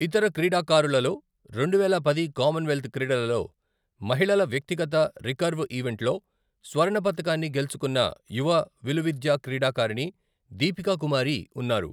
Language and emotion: Telugu, neutral